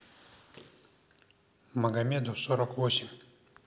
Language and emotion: Russian, neutral